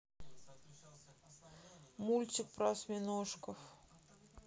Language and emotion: Russian, sad